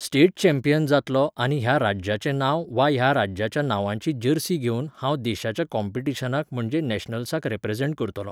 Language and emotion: Goan Konkani, neutral